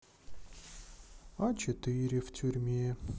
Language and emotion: Russian, sad